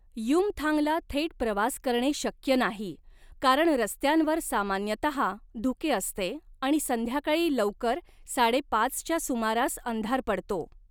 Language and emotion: Marathi, neutral